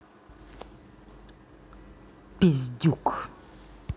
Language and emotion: Russian, angry